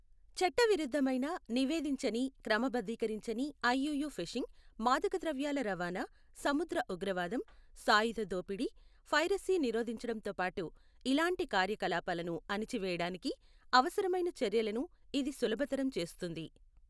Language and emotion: Telugu, neutral